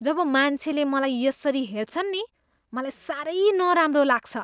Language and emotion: Nepali, disgusted